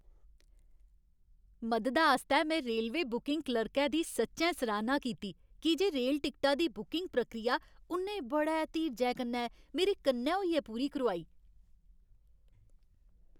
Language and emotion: Dogri, happy